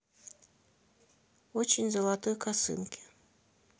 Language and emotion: Russian, neutral